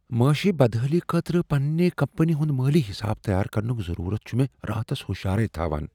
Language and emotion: Kashmiri, fearful